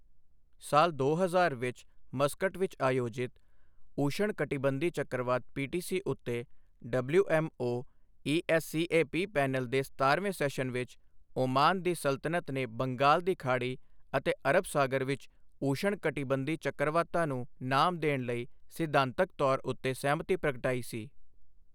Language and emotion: Punjabi, neutral